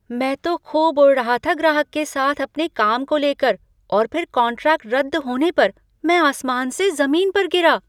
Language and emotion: Hindi, surprised